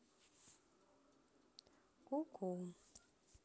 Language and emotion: Russian, neutral